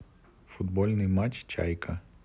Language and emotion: Russian, neutral